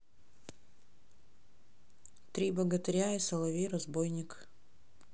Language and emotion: Russian, neutral